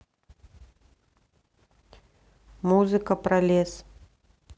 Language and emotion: Russian, neutral